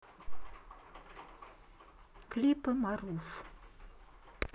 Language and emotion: Russian, neutral